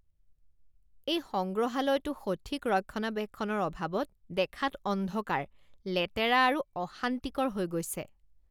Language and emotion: Assamese, disgusted